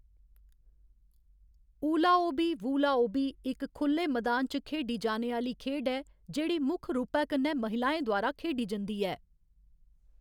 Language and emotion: Dogri, neutral